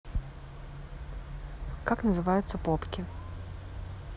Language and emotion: Russian, neutral